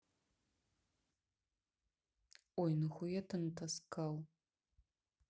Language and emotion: Russian, neutral